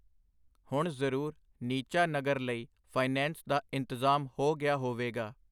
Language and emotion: Punjabi, neutral